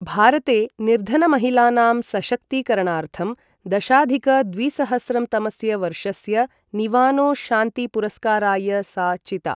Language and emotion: Sanskrit, neutral